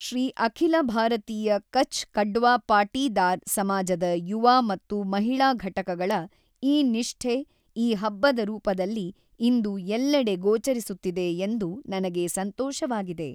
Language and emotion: Kannada, neutral